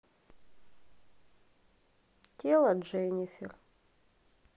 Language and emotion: Russian, sad